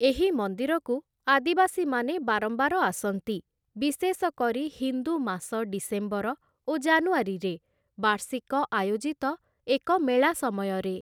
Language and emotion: Odia, neutral